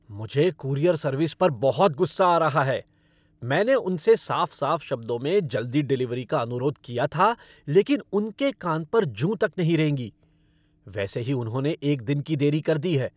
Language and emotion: Hindi, angry